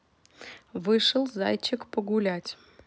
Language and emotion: Russian, neutral